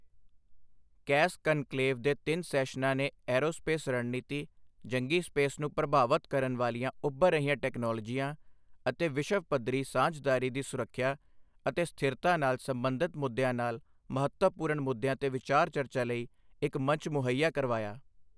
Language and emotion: Punjabi, neutral